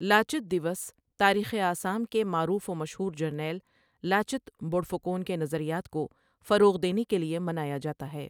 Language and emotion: Urdu, neutral